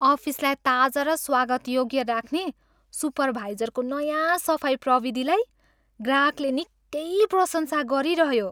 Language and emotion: Nepali, happy